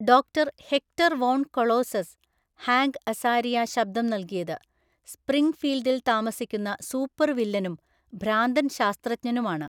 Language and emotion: Malayalam, neutral